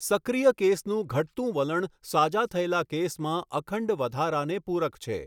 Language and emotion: Gujarati, neutral